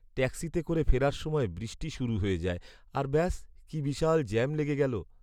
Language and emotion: Bengali, sad